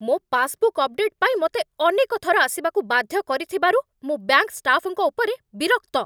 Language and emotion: Odia, angry